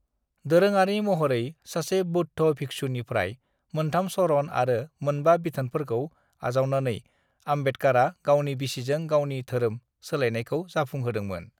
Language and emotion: Bodo, neutral